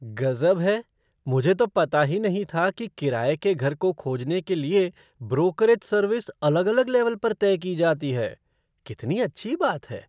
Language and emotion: Hindi, surprised